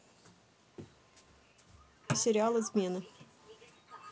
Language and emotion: Russian, neutral